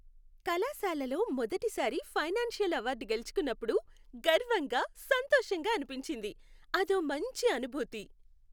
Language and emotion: Telugu, happy